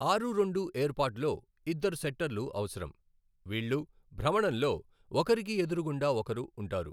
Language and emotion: Telugu, neutral